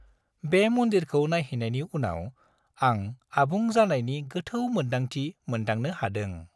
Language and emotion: Bodo, happy